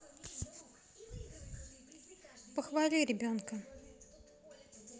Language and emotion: Russian, neutral